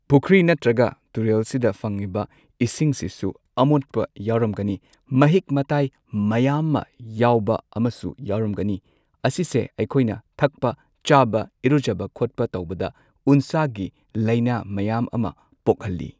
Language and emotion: Manipuri, neutral